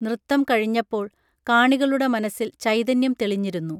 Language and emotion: Malayalam, neutral